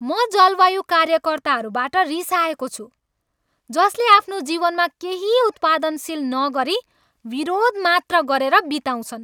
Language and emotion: Nepali, angry